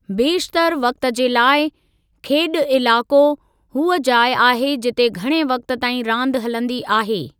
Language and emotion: Sindhi, neutral